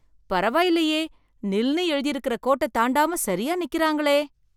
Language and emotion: Tamil, surprised